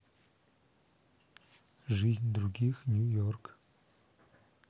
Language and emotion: Russian, neutral